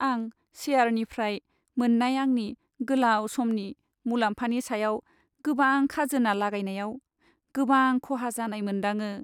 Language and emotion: Bodo, sad